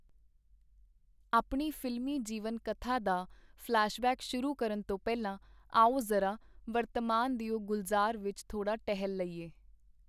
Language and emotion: Punjabi, neutral